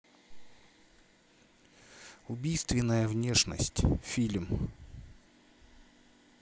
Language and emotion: Russian, neutral